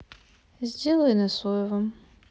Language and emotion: Russian, sad